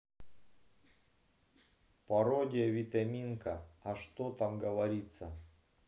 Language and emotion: Russian, neutral